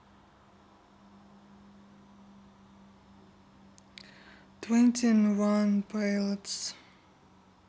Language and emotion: Russian, sad